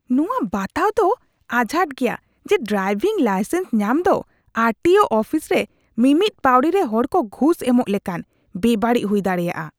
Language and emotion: Santali, disgusted